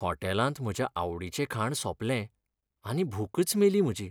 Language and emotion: Goan Konkani, sad